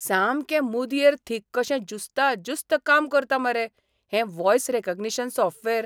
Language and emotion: Goan Konkani, surprised